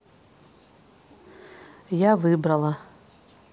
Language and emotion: Russian, neutral